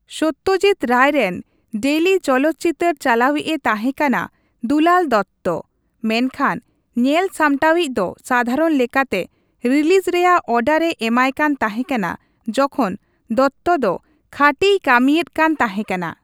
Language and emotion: Santali, neutral